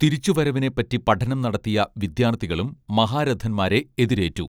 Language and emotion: Malayalam, neutral